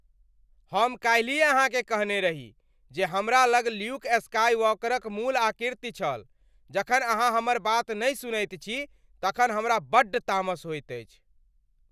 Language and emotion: Maithili, angry